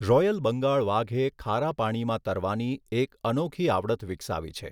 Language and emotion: Gujarati, neutral